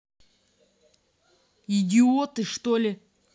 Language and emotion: Russian, angry